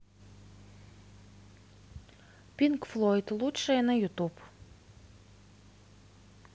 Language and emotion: Russian, neutral